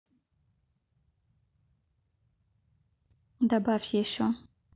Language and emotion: Russian, neutral